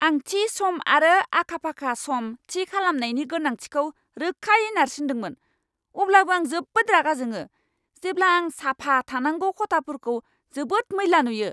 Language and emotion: Bodo, angry